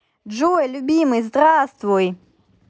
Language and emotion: Russian, positive